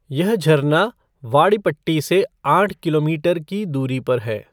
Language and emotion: Hindi, neutral